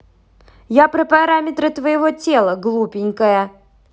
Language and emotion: Russian, angry